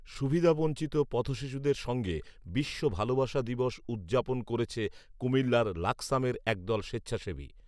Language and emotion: Bengali, neutral